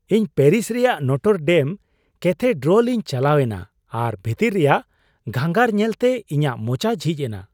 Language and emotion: Santali, surprised